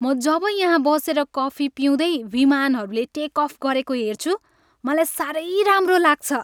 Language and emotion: Nepali, happy